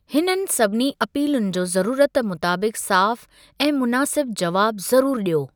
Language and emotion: Sindhi, neutral